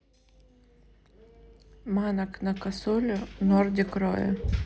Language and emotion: Russian, neutral